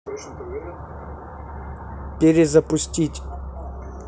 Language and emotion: Russian, neutral